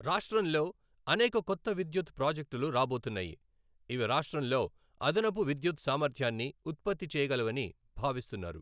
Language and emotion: Telugu, neutral